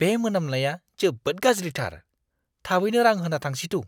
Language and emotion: Bodo, disgusted